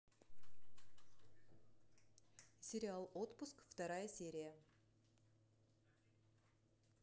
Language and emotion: Russian, neutral